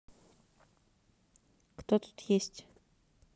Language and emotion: Russian, neutral